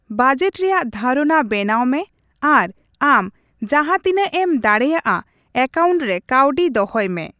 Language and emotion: Santali, neutral